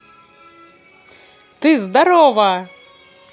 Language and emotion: Russian, positive